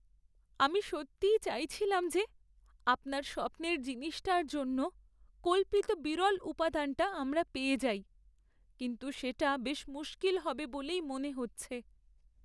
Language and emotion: Bengali, sad